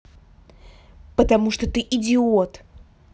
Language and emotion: Russian, angry